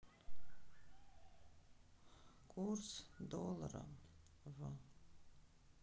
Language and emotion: Russian, sad